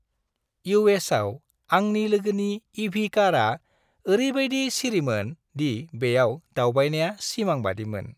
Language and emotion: Bodo, happy